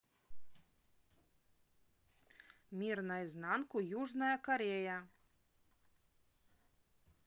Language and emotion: Russian, neutral